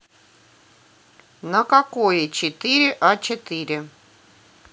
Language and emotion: Russian, neutral